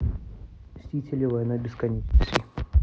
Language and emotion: Russian, neutral